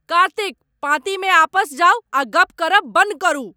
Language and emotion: Maithili, angry